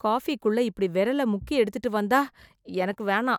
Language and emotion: Tamil, disgusted